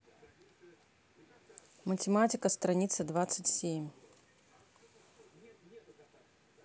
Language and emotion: Russian, neutral